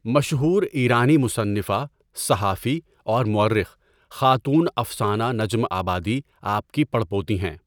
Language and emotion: Urdu, neutral